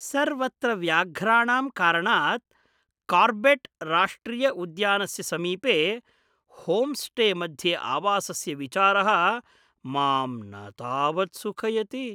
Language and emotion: Sanskrit, fearful